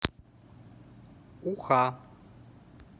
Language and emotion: Russian, neutral